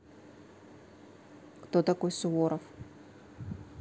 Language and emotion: Russian, neutral